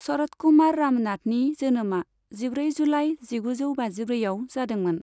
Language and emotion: Bodo, neutral